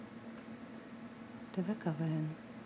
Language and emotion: Russian, neutral